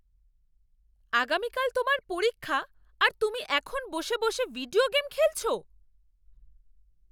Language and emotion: Bengali, angry